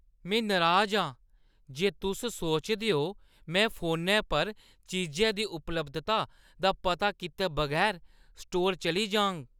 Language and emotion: Dogri, disgusted